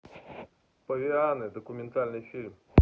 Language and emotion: Russian, neutral